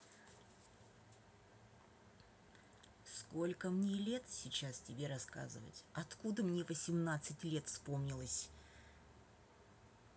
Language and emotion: Russian, angry